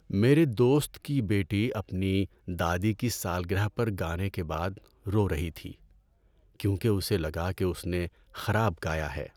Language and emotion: Urdu, sad